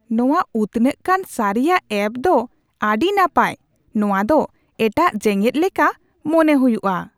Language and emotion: Santali, surprised